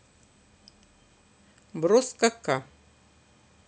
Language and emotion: Russian, neutral